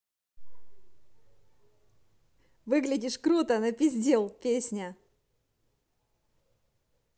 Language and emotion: Russian, positive